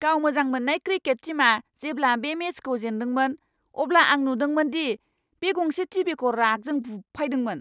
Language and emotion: Bodo, angry